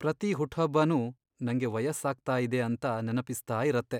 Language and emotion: Kannada, sad